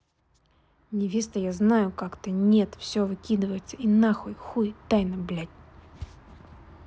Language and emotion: Russian, angry